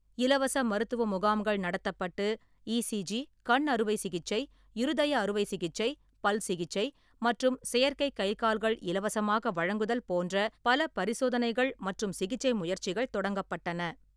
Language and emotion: Tamil, neutral